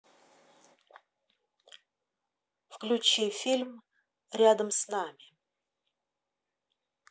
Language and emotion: Russian, neutral